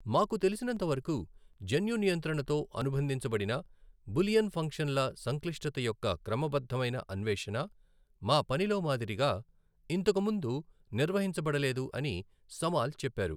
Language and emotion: Telugu, neutral